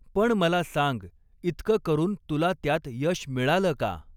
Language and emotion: Marathi, neutral